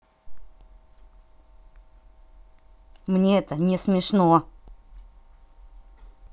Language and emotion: Russian, angry